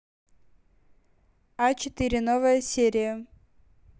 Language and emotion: Russian, neutral